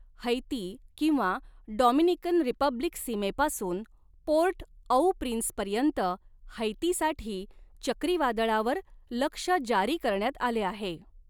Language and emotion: Marathi, neutral